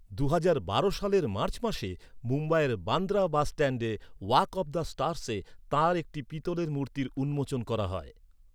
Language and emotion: Bengali, neutral